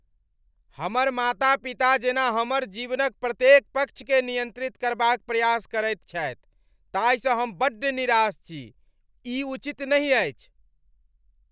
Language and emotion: Maithili, angry